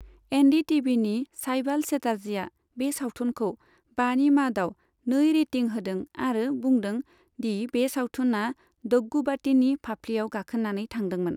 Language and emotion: Bodo, neutral